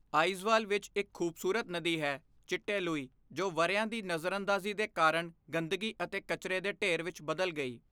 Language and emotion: Punjabi, neutral